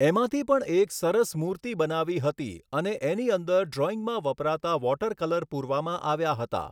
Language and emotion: Gujarati, neutral